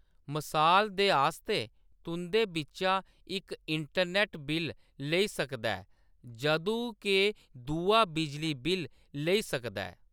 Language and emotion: Dogri, neutral